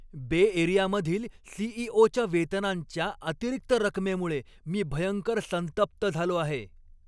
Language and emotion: Marathi, angry